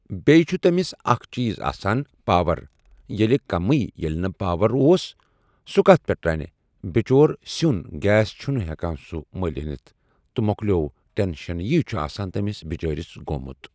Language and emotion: Kashmiri, neutral